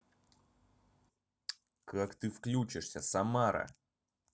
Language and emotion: Russian, angry